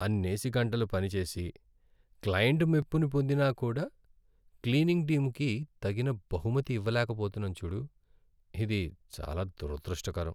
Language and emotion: Telugu, sad